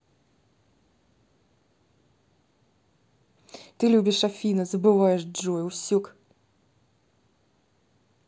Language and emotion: Russian, neutral